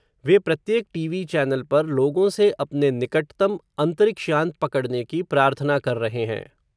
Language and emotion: Hindi, neutral